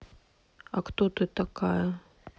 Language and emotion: Russian, sad